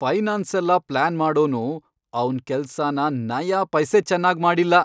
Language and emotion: Kannada, angry